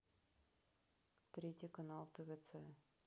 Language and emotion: Russian, neutral